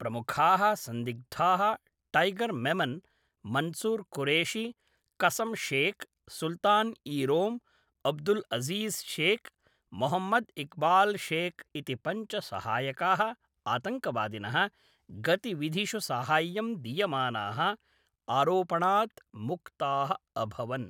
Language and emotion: Sanskrit, neutral